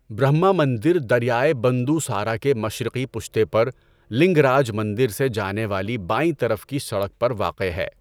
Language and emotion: Urdu, neutral